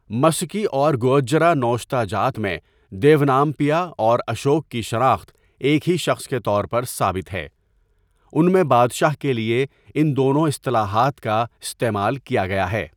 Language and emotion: Urdu, neutral